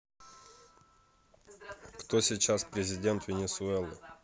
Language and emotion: Russian, neutral